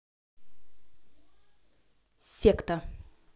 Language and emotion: Russian, neutral